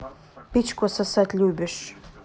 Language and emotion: Russian, neutral